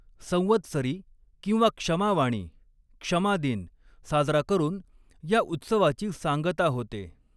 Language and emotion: Marathi, neutral